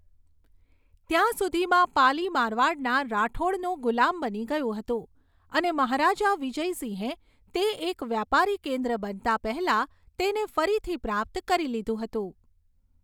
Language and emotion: Gujarati, neutral